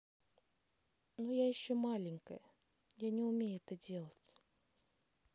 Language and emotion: Russian, sad